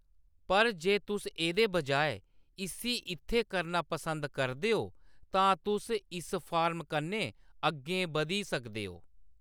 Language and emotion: Dogri, neutral